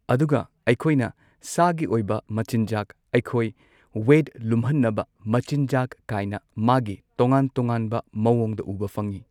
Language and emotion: Manipuri, neutral